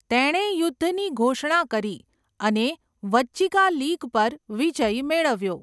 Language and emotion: Gujarati, neutral